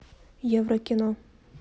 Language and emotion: Russian, neutral